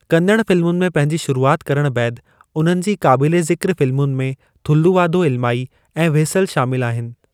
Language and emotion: Sindhi, neutral